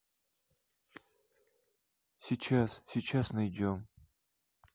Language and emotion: Russian, neutral